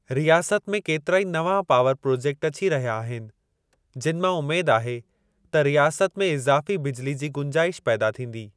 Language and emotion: Sindhi, neutral